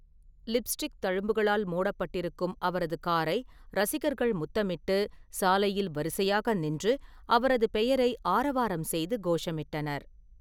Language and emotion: Tamil, neutral